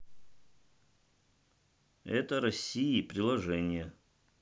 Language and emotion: Russian, neutral